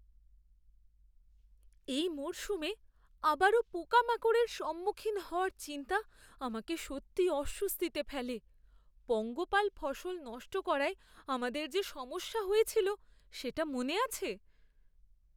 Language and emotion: Bengali, fearful